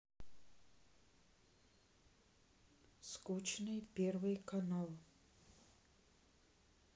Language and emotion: Russian, sad